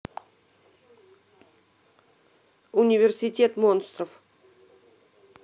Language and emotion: Russian, neutral